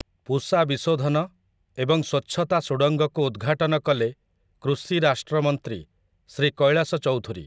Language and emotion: Odia, neutral